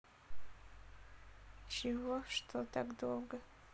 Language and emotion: Russian, sad